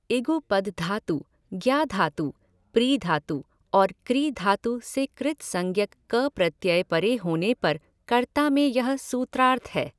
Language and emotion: Hindi, neutral